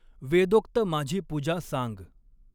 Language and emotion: Marathi, neutral